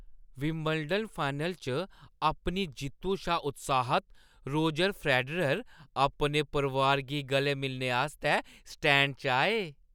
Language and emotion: Dogri, happy